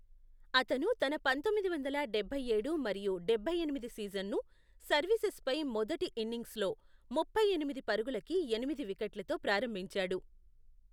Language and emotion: Telugu, neutral